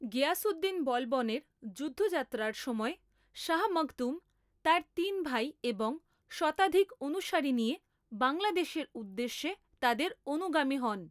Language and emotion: Bengali, neutral